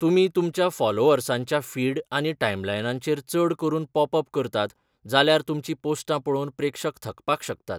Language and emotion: Goan Konkani, neutral